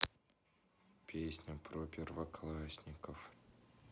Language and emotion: Russian, sad